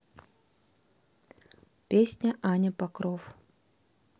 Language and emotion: Russian, neutral